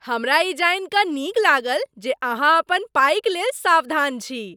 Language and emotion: Maithili, happy